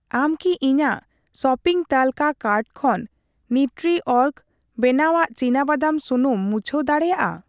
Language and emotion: Santali, neutral